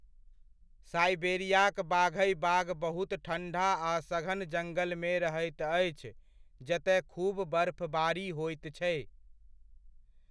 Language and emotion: Maithili, neutral